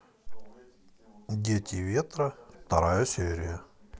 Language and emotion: Russian, neutral